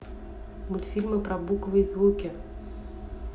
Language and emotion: Russian, neutral